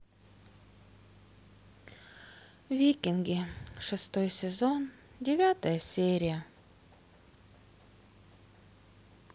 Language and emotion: Russian, sad